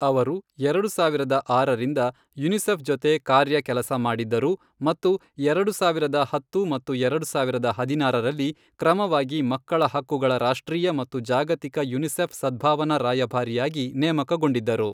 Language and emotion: Kannada, neutral